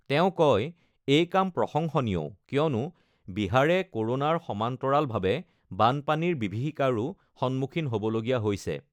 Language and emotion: Assamese, neutral